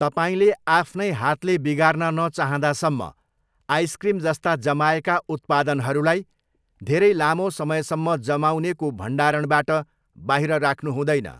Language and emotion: Nepali, neutral